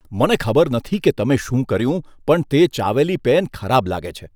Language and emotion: Gujarati, disgusted